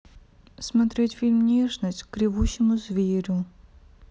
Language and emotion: Russian, sad